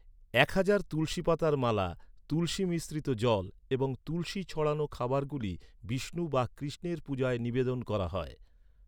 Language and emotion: Bengali, neutral